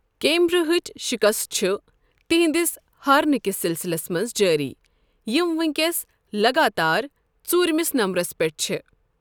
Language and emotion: Kashmiri, neutral